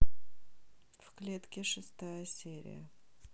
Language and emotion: Russian, neutral